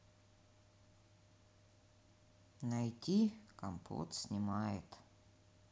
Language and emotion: Russian, sad